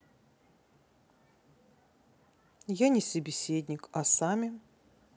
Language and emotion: Russian, neutral